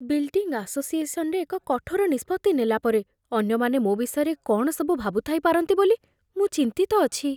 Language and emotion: Odia, fearful